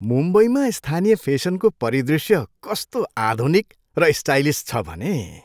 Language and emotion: Nepali, happy